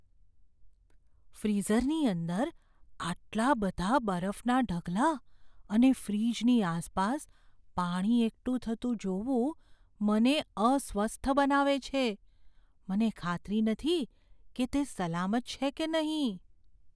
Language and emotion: Gujarati, fearful